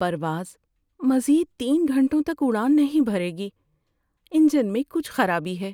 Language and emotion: Urdu, sad